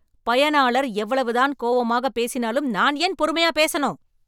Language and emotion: Tamil, angry